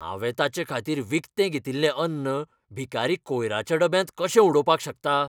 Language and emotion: Goan Konkani, angry